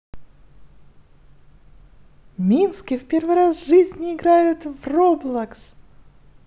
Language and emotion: Russian, positive